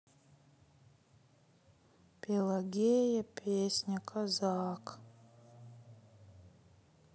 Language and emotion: Russian, sad